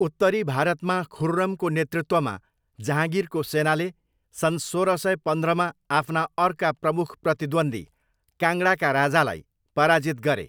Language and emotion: Nepali, neutral